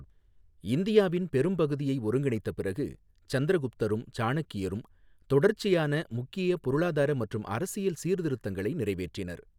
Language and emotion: Tamil, neutral